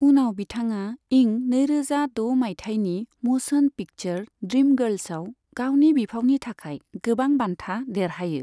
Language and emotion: Bodo, neutral